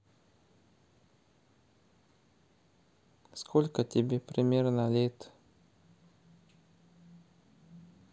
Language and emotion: Russian, neutral